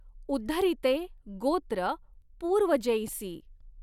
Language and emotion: Marathi, neutral